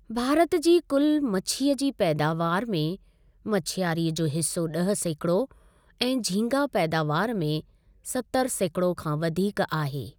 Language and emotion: Sindhi, neutral